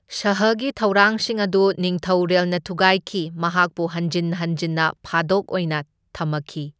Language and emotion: Manipuri, neutral